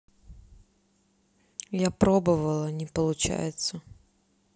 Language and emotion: Russian, neutral